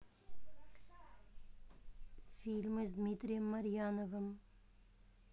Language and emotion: Russian, neutral